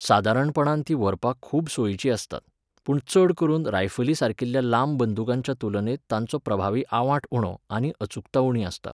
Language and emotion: Goan Konkani, neutral